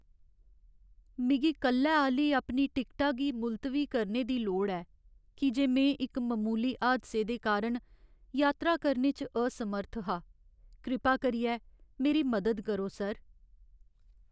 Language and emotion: Dogri, sad